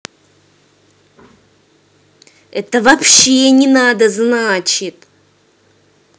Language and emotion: Russian, angry